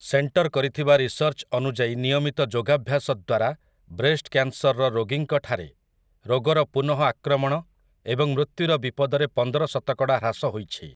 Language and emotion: Odia, neutral